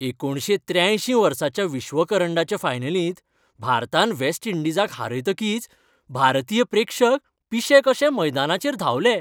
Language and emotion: Goan Konkani, happy